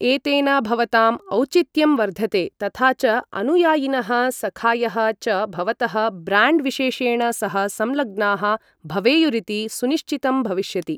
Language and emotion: Sanskrit, neutral